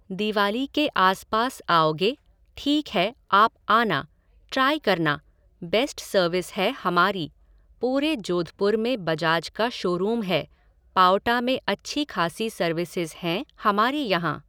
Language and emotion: Hindi, neutral